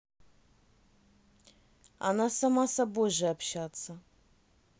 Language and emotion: Russian, neutral